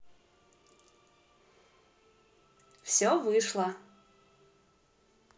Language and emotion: Russian, positive